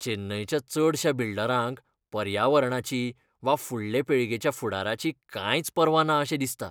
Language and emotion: Goan Konkani, disgusted